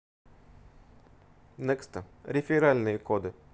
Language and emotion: Russian, neutral